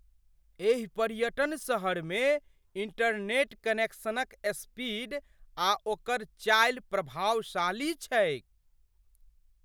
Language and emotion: Maithili, surprised